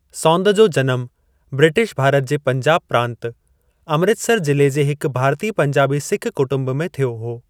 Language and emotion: Sindhi, neutral